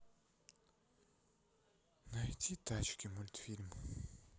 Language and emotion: Russian, sad